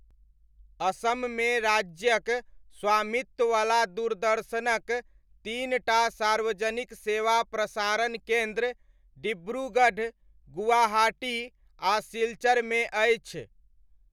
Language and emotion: Maithili, neutral